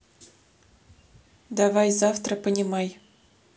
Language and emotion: Russian, neutral